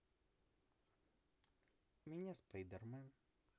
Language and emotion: Russian, neutral